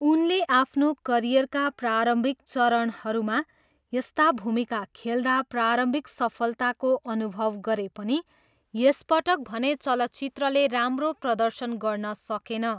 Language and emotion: Nepali, neutral